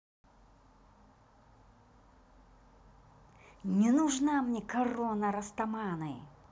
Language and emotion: Russian, angry